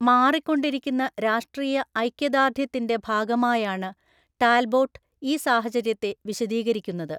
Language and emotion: Malayalam, neutral